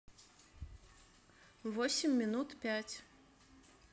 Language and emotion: Russian, neutral